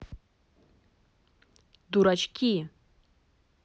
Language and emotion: Russian, neutral